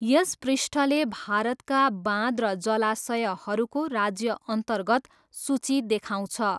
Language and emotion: Nepali, neutral